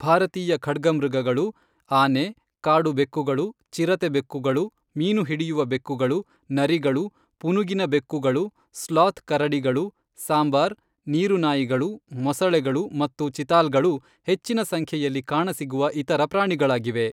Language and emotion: Kannada, neutral